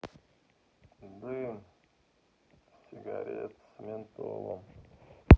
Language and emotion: Russian, sad